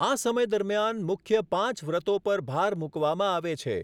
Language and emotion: Gujarati, neutral